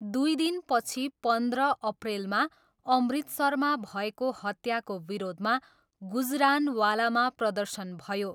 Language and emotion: Nepali, neutral